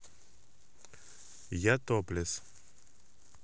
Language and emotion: Russian, neutral